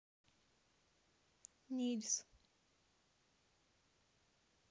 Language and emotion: Russian, neutral